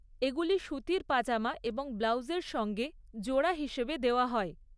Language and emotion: Bengali, neutral